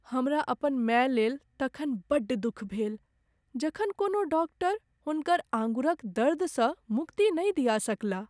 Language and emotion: Maithili, sad